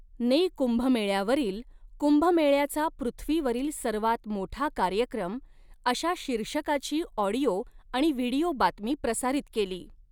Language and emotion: Marathi, neutral